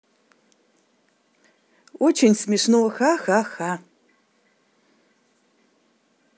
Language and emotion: Russian, positive